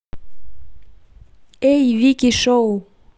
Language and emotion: Russian, positive